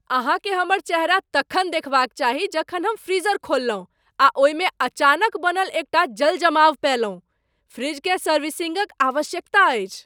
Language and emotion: Maithili, surprised